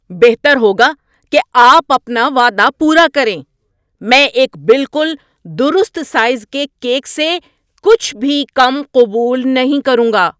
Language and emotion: Urdu, angry